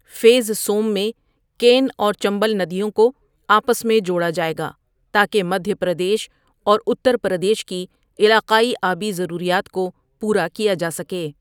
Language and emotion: Urdu, neutral